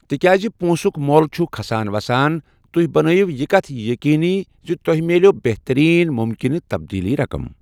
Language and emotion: Kashmiri, neutral